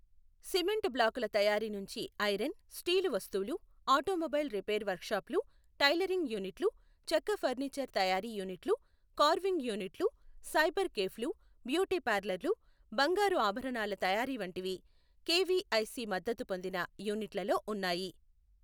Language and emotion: Telugu, neutral